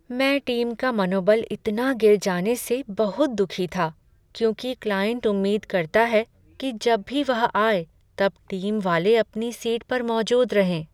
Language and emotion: Hindi, sad